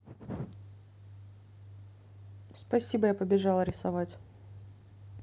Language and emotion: Russian, neutral